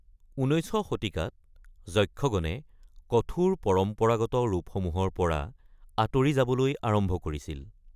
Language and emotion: Assamese, neutral